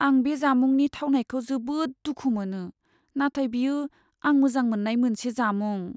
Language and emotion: Bodo, sad